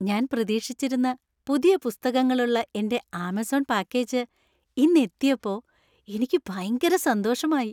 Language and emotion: Malayalam, happy